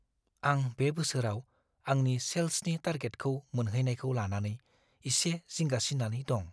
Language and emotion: Bodo, fearful